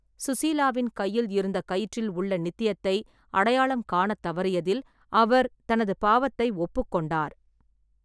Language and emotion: Tamil, neutral